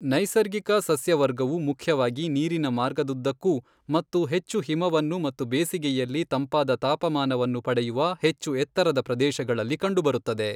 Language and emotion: Kannada, neutral